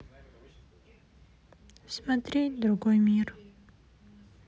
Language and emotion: Russian, sad